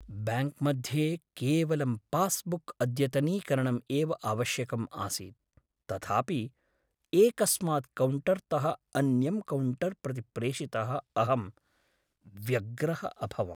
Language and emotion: Sanskrit, sad